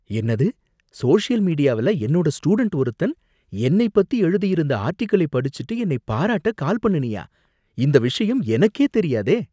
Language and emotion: Tamil, surprised